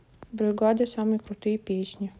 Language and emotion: Russian, neutral